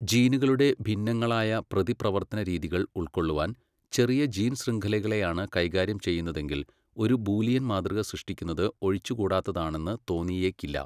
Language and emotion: Malayalam, neutral